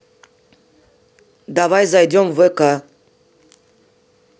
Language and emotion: Russian, neutral